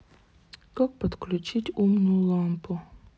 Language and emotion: Russian, sad